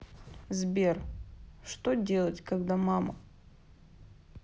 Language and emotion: Russian, sad